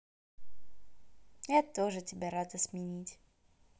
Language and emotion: Russian, positive